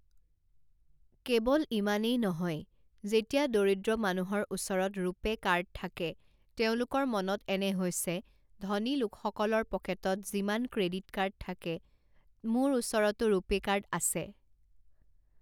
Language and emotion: Assamese, neutral